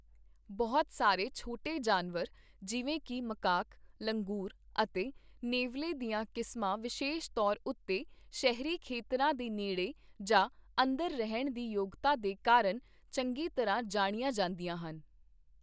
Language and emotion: Punjabi, neutral